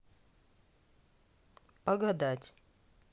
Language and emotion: Russian, neutral